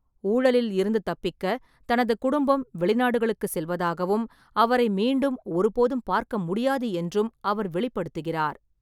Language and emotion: Tamil, neutral